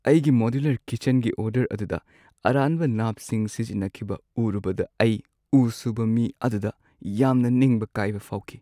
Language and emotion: Manipuri, sad